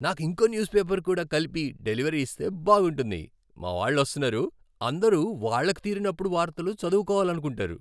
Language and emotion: Telugu, happy